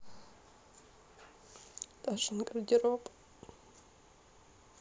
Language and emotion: Russian, sad